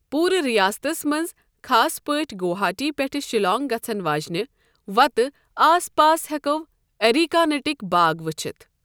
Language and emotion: Kashmiri, neutral